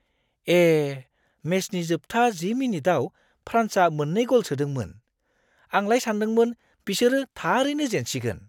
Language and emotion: Bodo, surprised